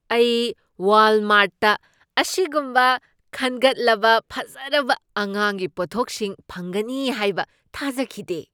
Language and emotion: Manipuri, surprised